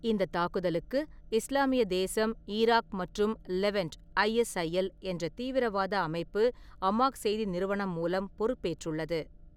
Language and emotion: Tamil, neutral